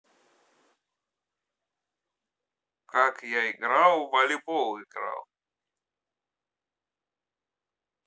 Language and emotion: Russian, neutral